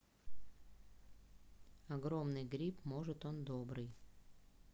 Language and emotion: Russian, neutral